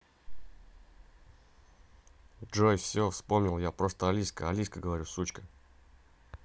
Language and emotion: Russian, neutral